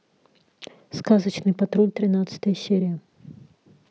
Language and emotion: Russian, neutral